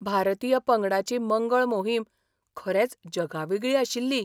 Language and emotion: Goan Konkani, surprised